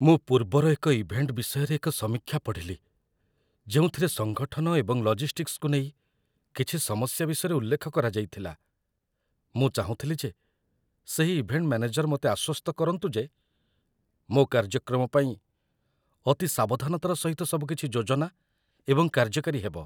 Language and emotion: Odia, fearful